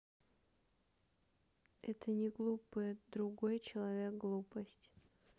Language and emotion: Russian, sad